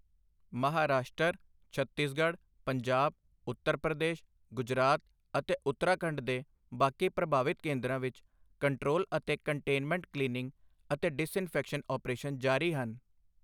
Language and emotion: Punjabi, neutral